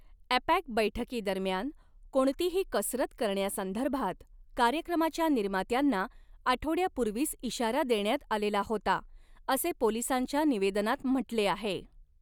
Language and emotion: Marathi, neutral